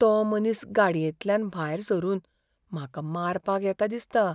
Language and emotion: Goan Konkani, fearful